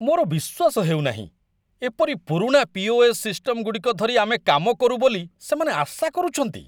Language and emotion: Odia, disgusted